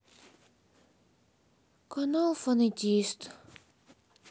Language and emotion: Russian, sad